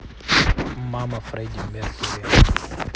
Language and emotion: Russian, neutral